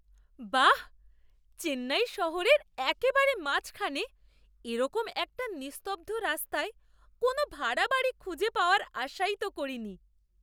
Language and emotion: Bengali, surprised